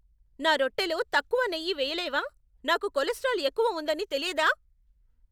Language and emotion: Telugu, angry